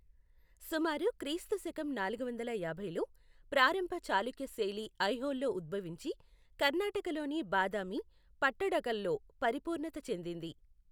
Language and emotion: Telugu, neutral